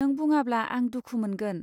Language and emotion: Bodo, neutral